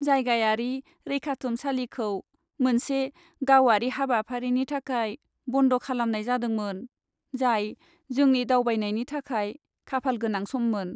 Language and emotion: Bodo, sad